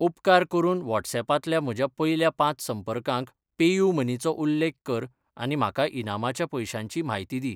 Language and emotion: Goan Konkani, neutral